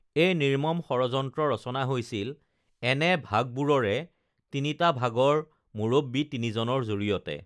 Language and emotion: Assamese, neutral